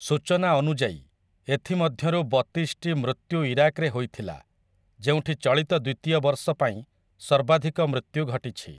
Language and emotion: Odia, neutral